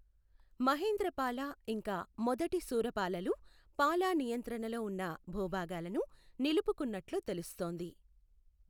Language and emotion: Telugu, neutral